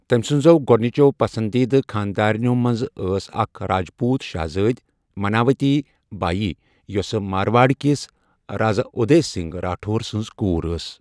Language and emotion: Kashmiri, neutral